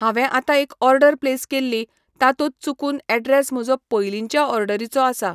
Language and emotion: Goan Konkani, neutral